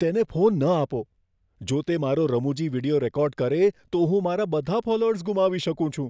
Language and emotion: Gujarati, fearful